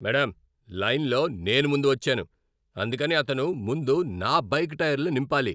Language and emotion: Telugu, angry